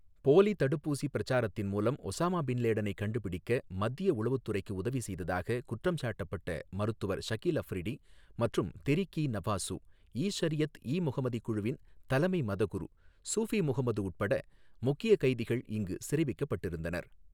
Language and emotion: Tamil, neutral